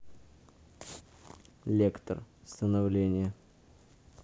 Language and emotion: Russian, neutral